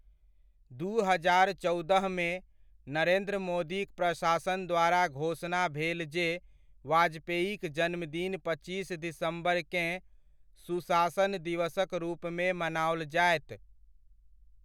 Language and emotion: Maithili, neutral